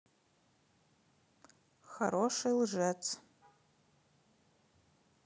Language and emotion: Russian, neutral